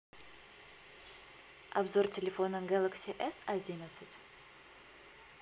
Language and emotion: Russian, neutral